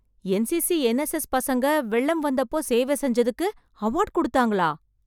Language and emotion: Tamil, surprised